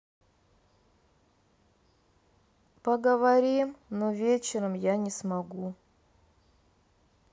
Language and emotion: Russian, sad